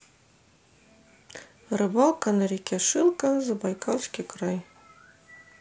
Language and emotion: Russian, neutral